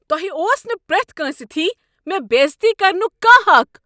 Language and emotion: Kashmiri, angry